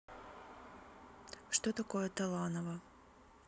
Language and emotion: Russian, neutral